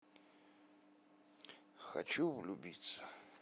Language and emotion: Russian, positive